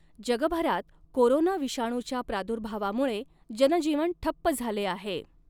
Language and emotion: Marathi, neutral